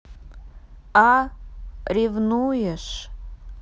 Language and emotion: Russian, neutral